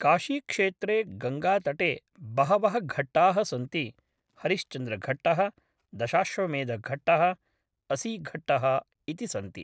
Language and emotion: Sanskrit, neutral